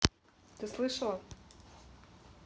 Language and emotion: Russian, neutral